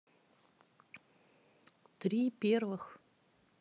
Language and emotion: Russian, neutral